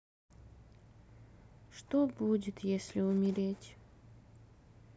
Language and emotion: Russian, sad